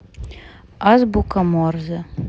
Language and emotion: Russian, neutral